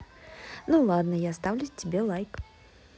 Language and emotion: Russian, positive